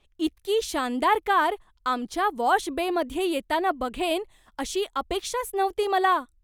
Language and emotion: Marathi, surprised